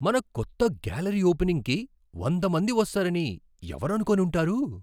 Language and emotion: Telugu, surprised